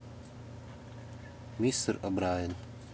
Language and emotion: Russian, neutral